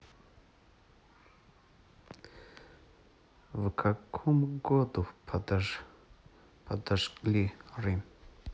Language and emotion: Russian, neutral